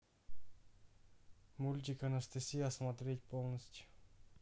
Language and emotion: Russian, neutral